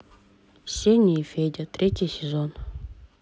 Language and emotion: Russian, neutral